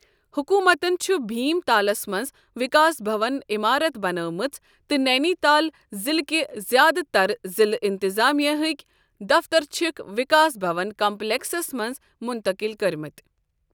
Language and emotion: Kashmiri, neutral